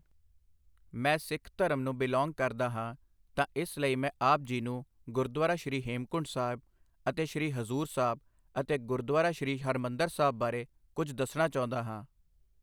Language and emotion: Punjabi, neutral